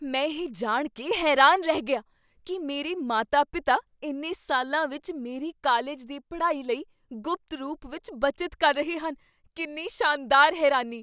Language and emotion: Punjabi, surprised